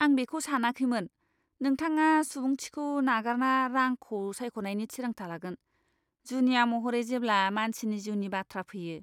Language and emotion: Bodo, disgusted